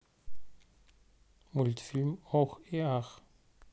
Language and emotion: Russian, neutral